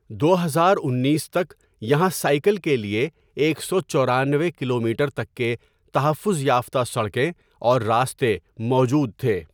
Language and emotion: Urdu, neutral